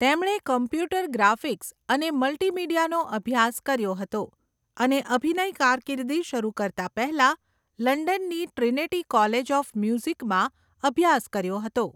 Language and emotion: Gujarati, neutral